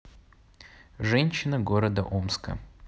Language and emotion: Russian, neutral